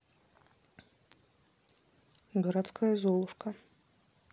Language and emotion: Russian, neutral